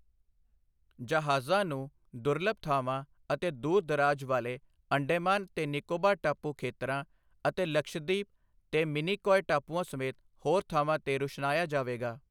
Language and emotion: Punjabi, neutral